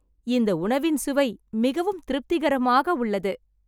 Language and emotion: Tamil, happy